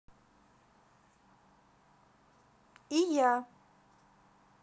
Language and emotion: Russian, positive